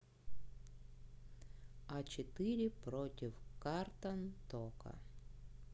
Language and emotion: Russian, neutral